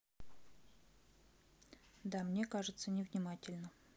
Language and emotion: Russian, neutral